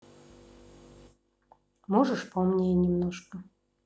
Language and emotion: Russian, neutral